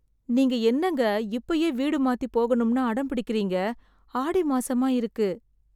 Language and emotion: Tamil, sad